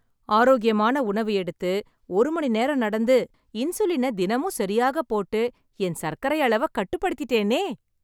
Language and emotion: Tamil, happy